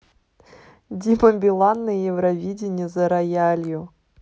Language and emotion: Russian, positive